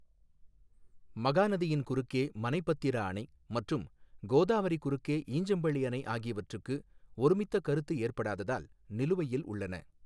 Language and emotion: Tamil, neutral